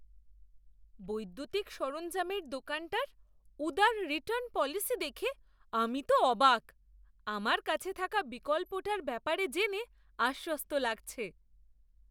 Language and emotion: Bengali, surprised